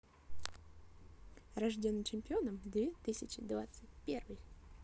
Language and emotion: Russian, positive